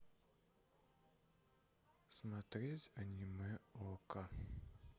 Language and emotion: Russian, sad